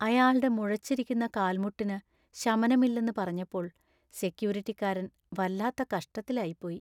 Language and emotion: Malayalam, sad